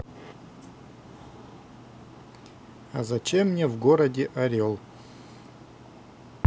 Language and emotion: Russian, neutral